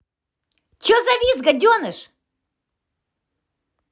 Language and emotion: Russian, angry